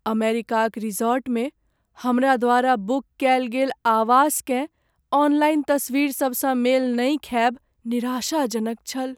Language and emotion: Maithili, sad